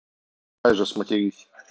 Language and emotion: Russian, neutral